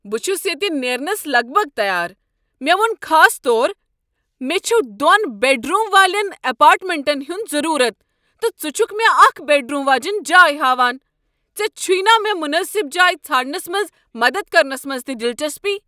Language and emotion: Kashmiri, angry